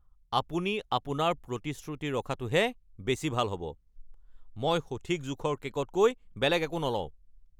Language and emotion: Assamese, angry